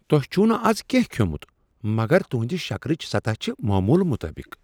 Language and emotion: Kashmiri, surprised